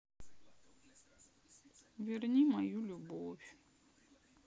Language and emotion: Russian, sad